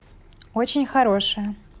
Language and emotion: Russian, positive